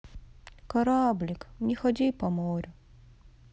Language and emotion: Russian, sad